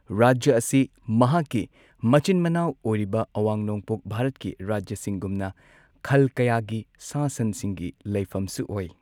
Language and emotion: Manipuri, neutral